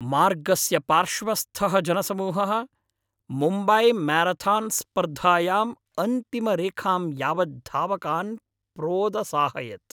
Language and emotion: Sanskrit, happy